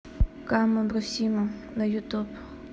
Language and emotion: Russian, neutral